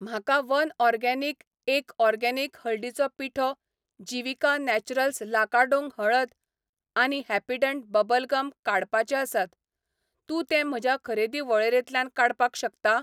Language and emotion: Goan Konkani, neutral